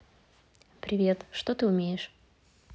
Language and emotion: Russian, neutral